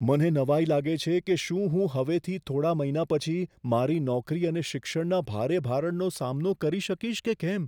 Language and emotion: Gujarati, fearful